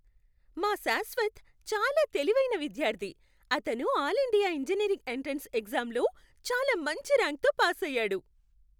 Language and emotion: Telugu, happy